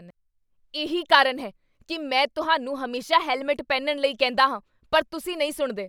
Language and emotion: Punjabi, angry